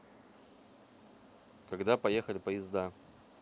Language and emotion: Russian, neutral